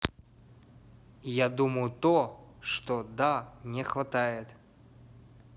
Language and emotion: Russian, neutral